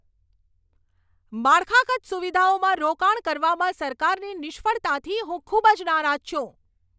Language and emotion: Gujarati, angry